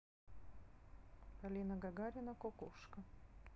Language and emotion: Russian, neutral